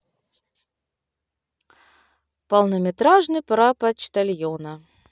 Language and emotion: Russian, positive